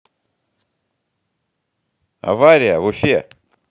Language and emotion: Russian, neutral